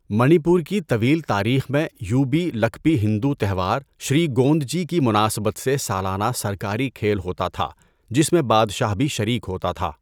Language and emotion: Urdu, neutral